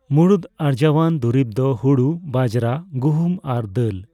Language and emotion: Santali, neutral